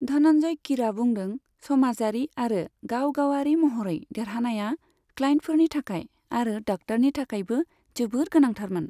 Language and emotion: Bodo, neutral